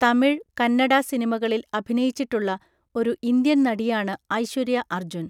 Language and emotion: Malayalam, neutral